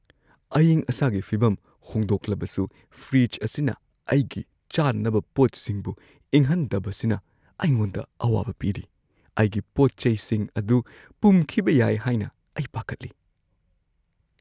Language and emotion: Manipuri, fearful